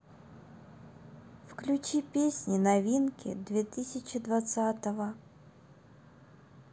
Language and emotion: Russian, sad